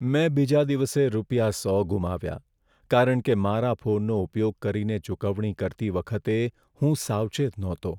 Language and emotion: Gujarati, sad